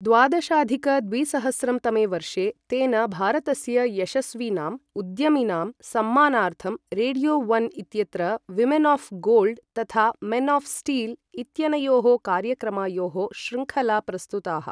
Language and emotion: Sanskrit, neutral